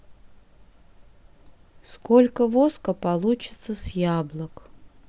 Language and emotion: Russian, neutral